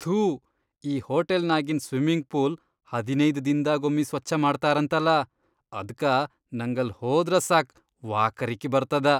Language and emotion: Kannada, disgusted